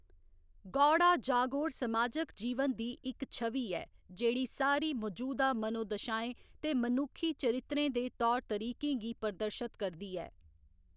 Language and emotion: Dogri, neutral